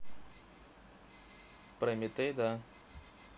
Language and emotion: Russian, neutral